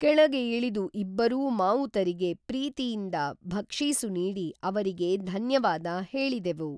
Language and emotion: Kannada, neutral